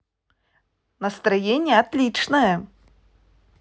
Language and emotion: Russian, positive